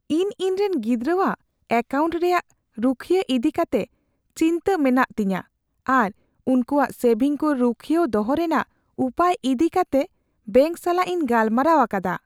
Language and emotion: Santali, fearful